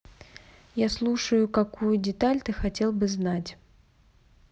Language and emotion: Russian, neutral